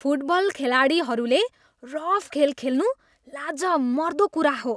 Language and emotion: Nepali, disgusted